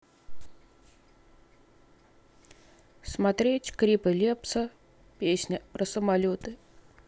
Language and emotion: Russian, neutral